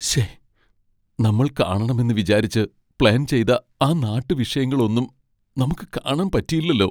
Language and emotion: Malayalam, sad